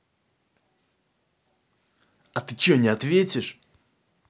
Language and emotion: Russian, angry